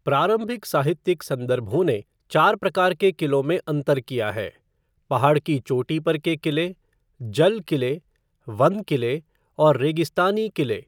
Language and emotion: Hindi, neutral